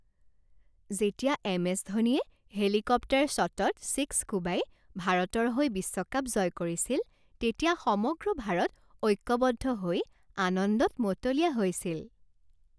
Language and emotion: Assamese, happy